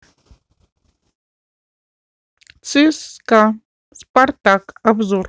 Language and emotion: Russian, neutral